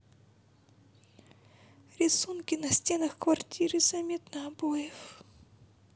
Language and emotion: Russian, sad